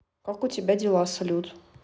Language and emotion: Russian, neutral